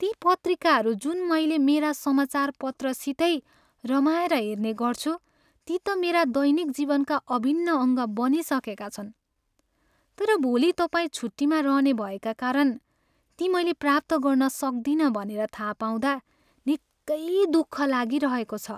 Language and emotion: Nepali, sad